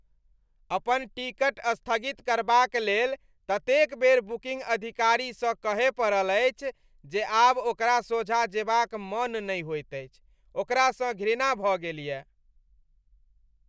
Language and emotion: Maithili, disgusted